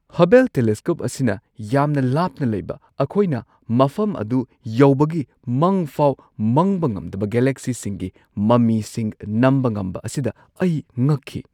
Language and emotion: Manipuri, surprised